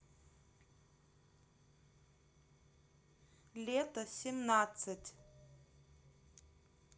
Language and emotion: Russian, neutral